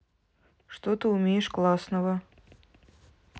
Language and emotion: Russian, neutral